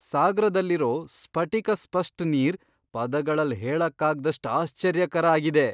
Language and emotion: Kannada, surprised